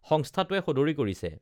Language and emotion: Assamese, neutral